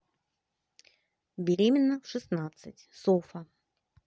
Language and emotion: Russian, neutral